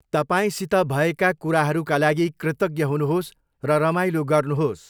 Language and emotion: Nepali, neutral